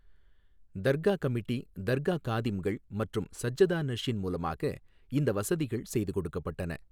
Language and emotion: Tamil, neutral